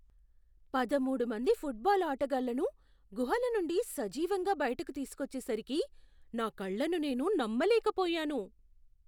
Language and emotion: Telugu, surprised